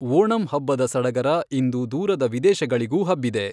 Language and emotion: Kannada, neutral